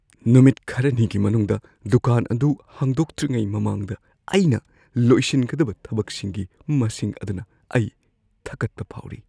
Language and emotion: Manipuri, fearful